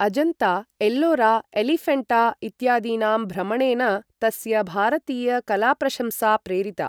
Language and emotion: Sanskrit, neutral